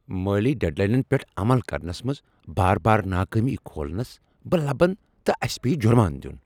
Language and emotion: Kashmiri, angry